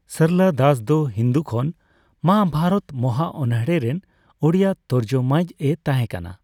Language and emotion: Santali, neutral